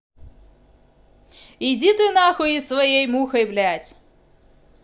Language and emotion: Russian, angry